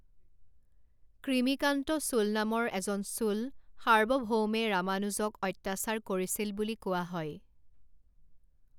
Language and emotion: Assamese, neutral